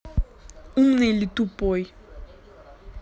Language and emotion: Russian, angry